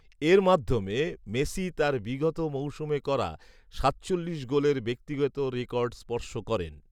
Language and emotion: Bengali, neutral